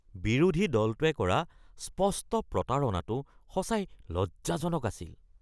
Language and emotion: Assamese, disgusted